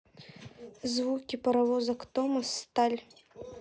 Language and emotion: Russian, neutral